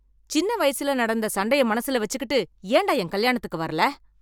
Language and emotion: Tamil, angry